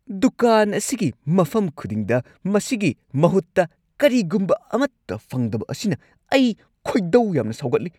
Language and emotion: Manipuri, angry